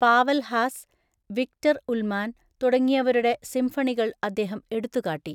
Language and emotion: Malayalam, neutral